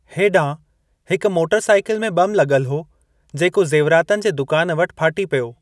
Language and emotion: Sindhi, neutral